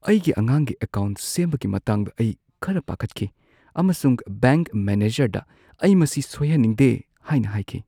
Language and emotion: Manipuri, fearful